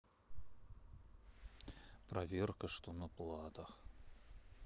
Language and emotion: Russian, neutral